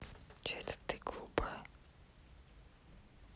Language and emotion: Russian, neutral